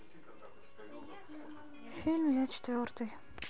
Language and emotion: Russian, sad